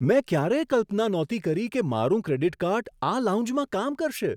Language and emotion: Gujarati, surprised